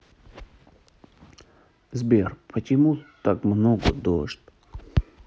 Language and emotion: Russian, sad